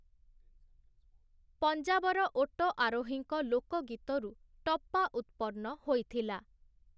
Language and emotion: Odia, neutral